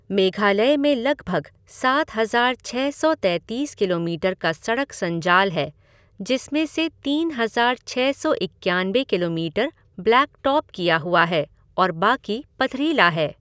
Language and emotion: Hindi, neutral